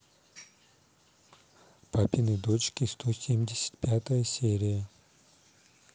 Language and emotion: Russian, neutral